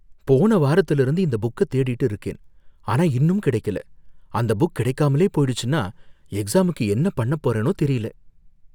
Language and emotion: Tamil, fearful